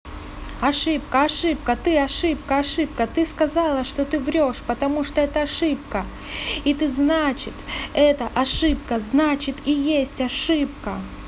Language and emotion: Russian, angry